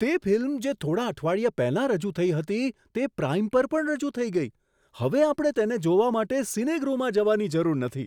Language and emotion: Gujarati, surprised